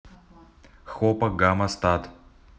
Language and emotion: Russian, neutral